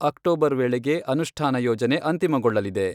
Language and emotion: Kannada, neutral